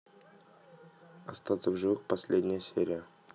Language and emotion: Russian, neutral